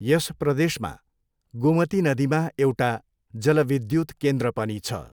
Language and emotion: Nepali, neutral